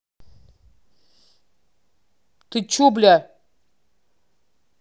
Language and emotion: Russian, angry